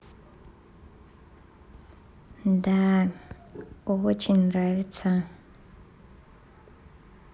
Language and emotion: Russian, positive